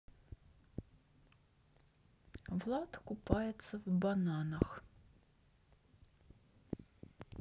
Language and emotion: Russian, neutral